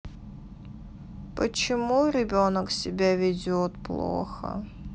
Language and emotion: Russian, sad